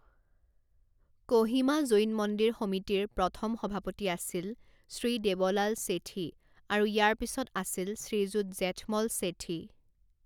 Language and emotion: Assamese, neutral